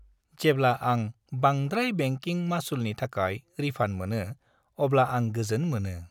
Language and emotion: Bodo, happy